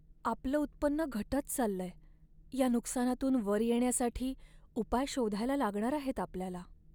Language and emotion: Marathi, sad